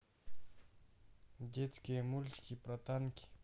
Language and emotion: Russian, neutral